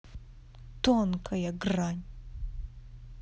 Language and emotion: Russian, angry